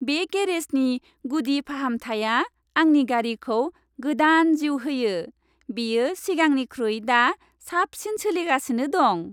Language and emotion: Bodo, happy